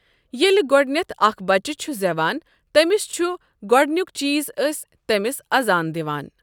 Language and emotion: Kashmiri, neutral